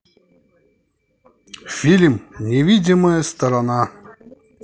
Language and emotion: Russian, positive